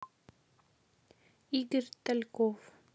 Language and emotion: Russian, neutral